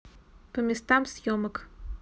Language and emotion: Russian, neutral